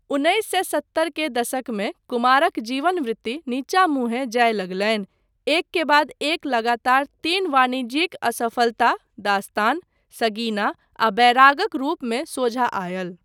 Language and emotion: Maithili, neutral